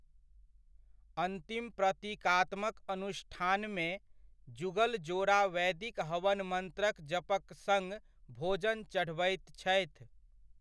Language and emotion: Maithili, neutral